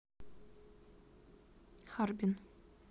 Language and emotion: Russian, neutral